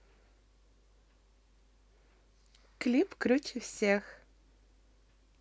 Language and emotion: Russian, positive